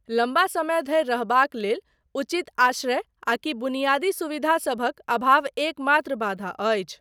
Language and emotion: Maithili, neutral